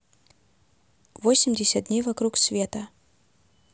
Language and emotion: Russian, neutral